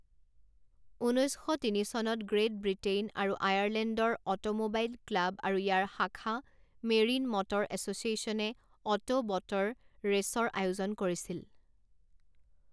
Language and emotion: Assamese, neutral